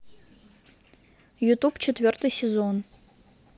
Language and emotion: Russian, neutral